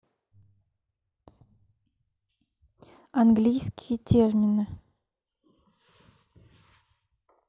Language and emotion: Russian, neutral